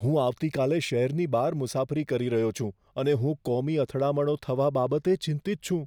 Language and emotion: Gujarati, fearful